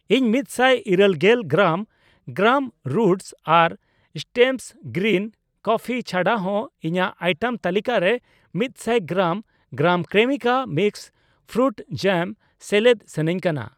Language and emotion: Santali, neutral